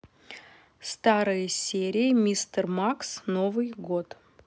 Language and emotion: Russian, neutral